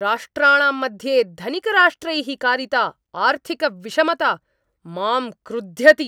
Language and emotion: Sanskrit, angry